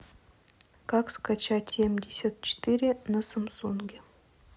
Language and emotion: Russian, neutral